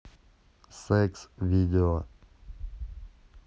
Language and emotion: Russian, neutral